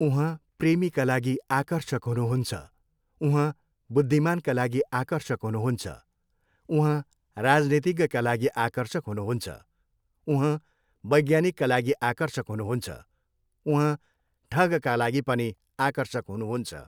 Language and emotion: Nepali, neutral